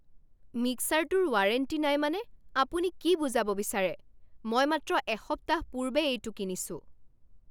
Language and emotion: Assamese, angry